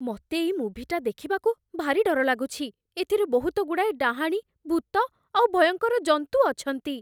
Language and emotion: Odia, fearful